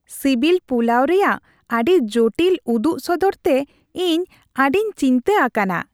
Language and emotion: Santali, happy